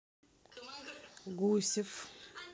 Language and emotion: Russian, neutral